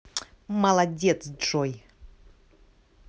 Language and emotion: Russian, positive